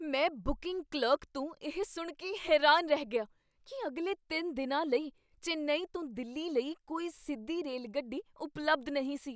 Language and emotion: Punjabi, surprised